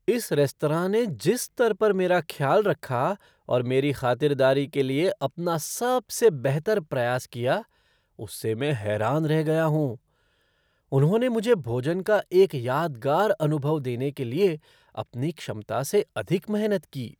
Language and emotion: Hindi, surprised